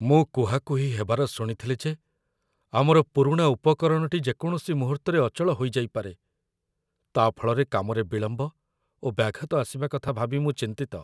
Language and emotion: Odia, fearful